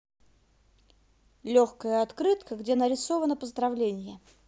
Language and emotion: Russian, positive